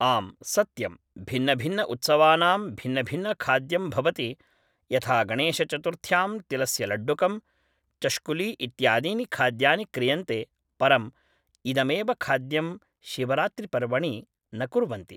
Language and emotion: Sanskrit, neutral